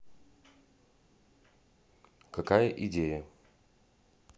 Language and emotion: Russian, neutral